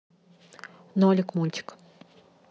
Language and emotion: Russian, neutral